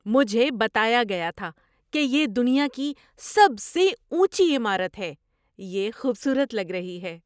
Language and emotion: Urdu, surprised